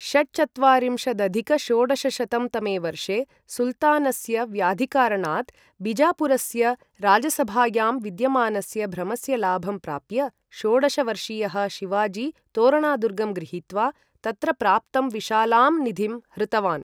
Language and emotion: Sanskrit, neutral